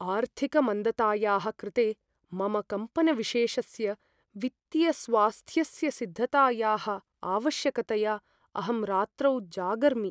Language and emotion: Sanskrit, fearful